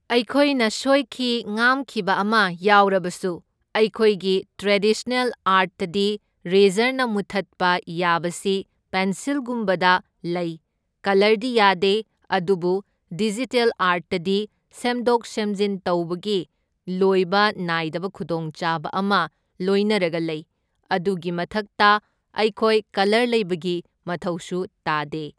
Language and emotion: Manipuri, neutral